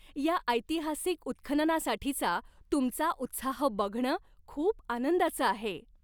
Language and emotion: Marathi, happy